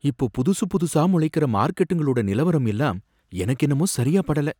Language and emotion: Tamil, fearful